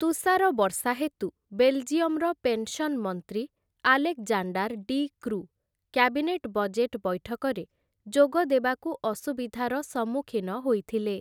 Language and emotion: Odia, neutral